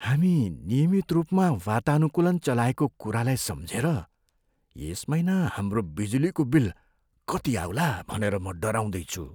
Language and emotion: Nepali, fearful